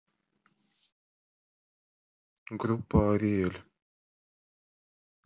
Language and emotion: Russian, neutral